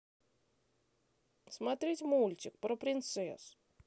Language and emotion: Russian, neutral